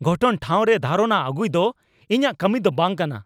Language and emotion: Santali, angry